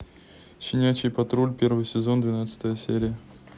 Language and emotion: Russian, neutral